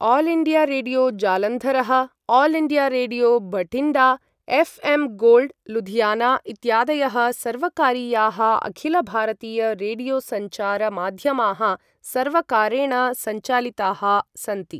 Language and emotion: Sanskrit, neutral